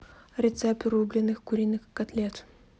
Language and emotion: Russian, neutral